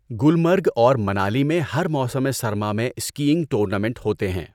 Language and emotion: Urdu, neutral